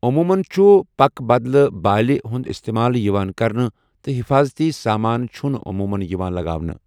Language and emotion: Kashmiri, neutral